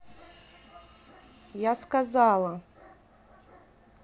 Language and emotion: Russian, angry